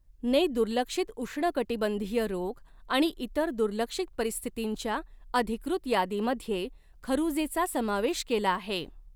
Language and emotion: Marathi, neutral